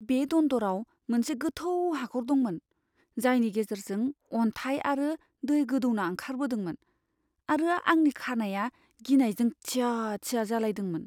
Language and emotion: Bodo, fearful